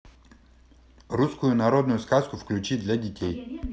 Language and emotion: Russian, neutral